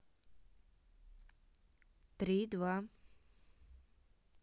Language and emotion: Russian, neutral